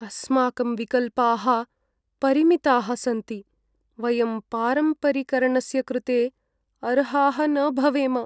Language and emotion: Sanskrit, sad